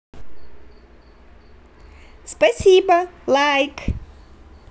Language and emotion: Russian, positive